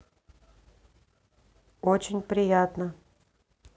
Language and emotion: Russian, neutral